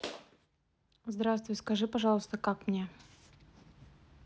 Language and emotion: Russian, neutral